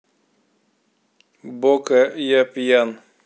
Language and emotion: Russian, neutral